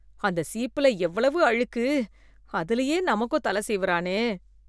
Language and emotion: Tamil, disgusted